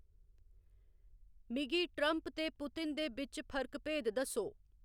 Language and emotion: Dogri, neutral